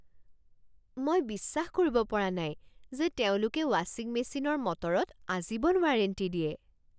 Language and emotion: Assamese, surprised